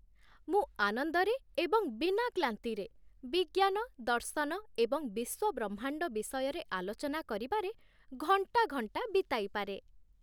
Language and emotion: Odia, happy